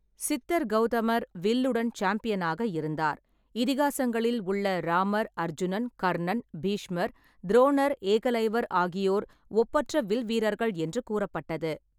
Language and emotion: Tamil, neutral